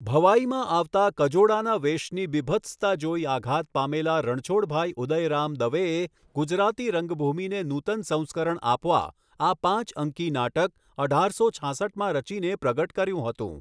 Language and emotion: Gujarati, neutral